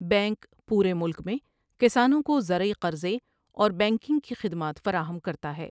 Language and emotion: Urdu, neutral